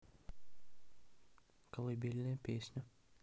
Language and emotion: Russian, neutral